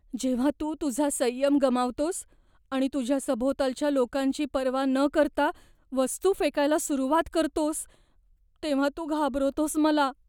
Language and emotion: Marathi, fearful